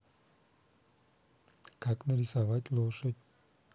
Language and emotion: Russian, neutral